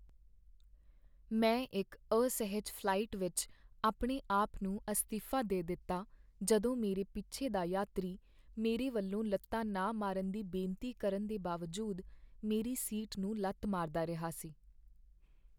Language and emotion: Punjabi, sad